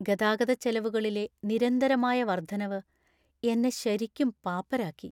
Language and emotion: Malayalam, sad